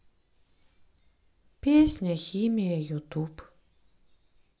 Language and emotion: Russian, sad